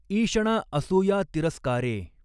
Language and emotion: Marathi, neutral